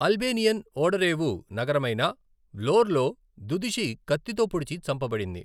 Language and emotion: Telugu, neutral